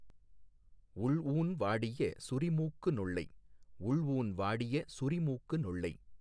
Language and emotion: Tamil, neutral